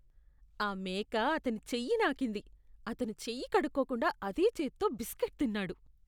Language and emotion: Telugu, disgusted